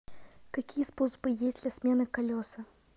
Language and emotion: Russian, neutral